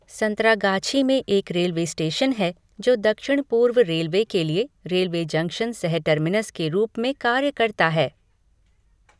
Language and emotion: Hindi, neutral